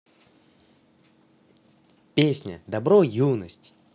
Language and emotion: Russian, positive